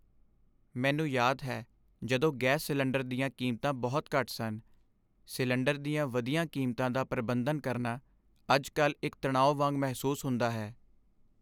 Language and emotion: Punjabi, sad